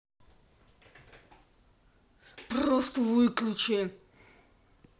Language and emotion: Russian, angry